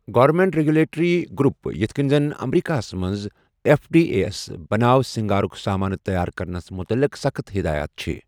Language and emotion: Kashmiri, neutral